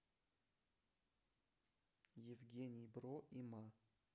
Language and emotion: Russian, neutral